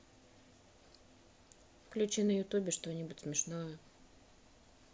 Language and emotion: Russian, neutral